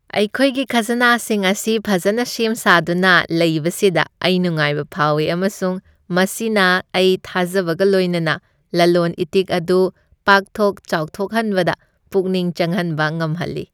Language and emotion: Manipuri, happy